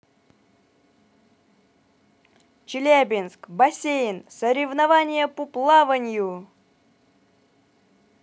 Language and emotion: Russian, positive